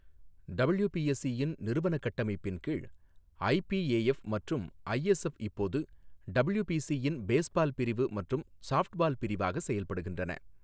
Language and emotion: Tamil, neutral